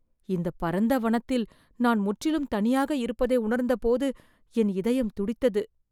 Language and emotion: Tamil, fearful